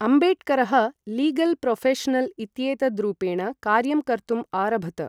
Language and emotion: Sanskrit, neutral